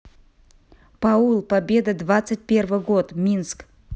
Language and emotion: Russian, neutral